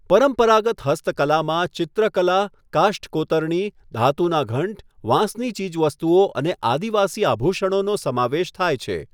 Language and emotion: Gujarati, neutral